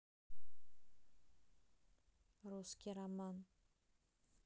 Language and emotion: Russian, neutral